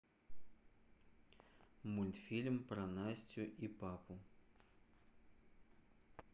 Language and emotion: Russian, neutral